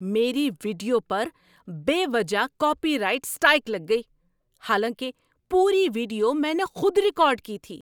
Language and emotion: Urdu, angry